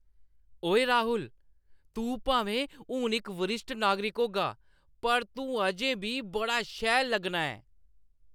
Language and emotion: Dogri, happy